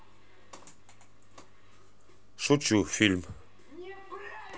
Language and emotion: Russian, neutral